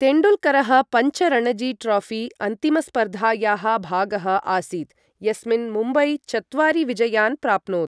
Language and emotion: Sanskrit, neutral